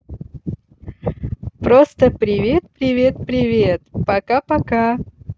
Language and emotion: Russian, positive